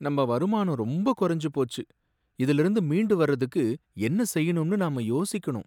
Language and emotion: Tamil, sad